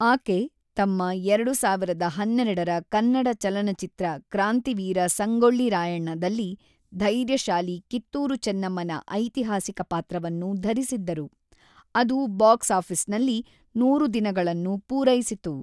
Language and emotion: Kannada, neutral